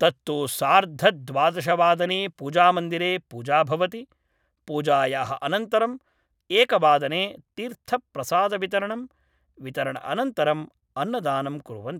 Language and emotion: Sanskrit, neutral